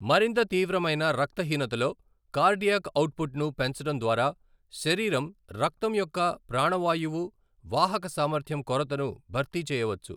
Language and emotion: Telugu, neutral